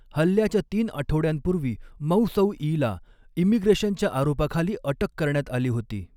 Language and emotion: Marathi, neutral